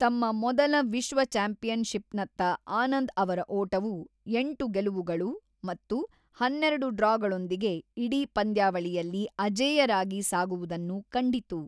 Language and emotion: Kannada, neutral